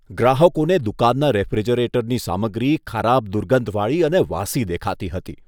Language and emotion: Gujarati, disgusted